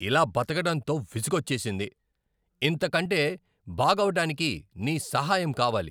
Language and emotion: Telugu, angry